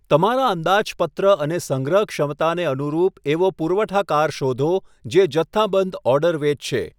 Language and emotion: Gujarati, neutral